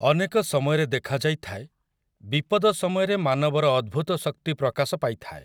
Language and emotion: Odia, neutral